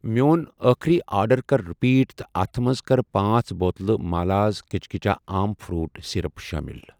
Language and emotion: Kashmiri, neutral